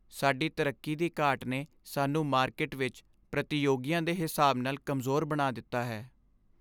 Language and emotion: Punjabi, sad